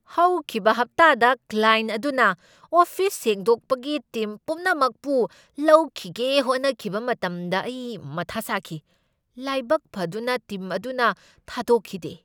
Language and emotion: Manipuri, angry